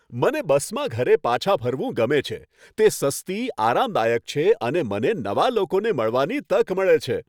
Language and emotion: Gujarati, happy